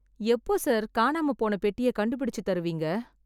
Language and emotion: Tamil, sad